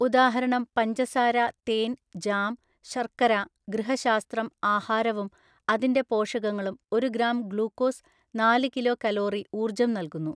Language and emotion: Malayalam, neutral